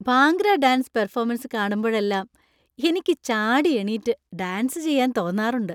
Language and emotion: Malayalam, happy